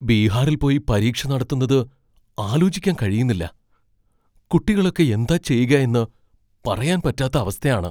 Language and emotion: Malayalam, fearful